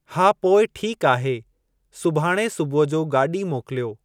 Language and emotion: Sindhi, neutral